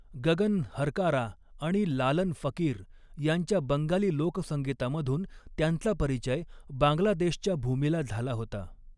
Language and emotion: Marathi, neutral